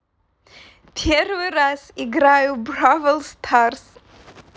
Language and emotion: Russian, positive